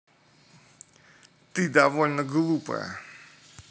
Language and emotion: Russian, angry